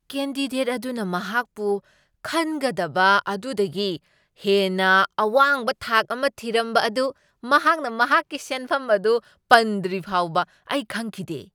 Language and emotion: Manipuri, surprised